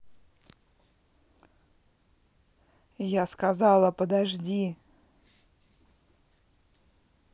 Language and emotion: Russian, angry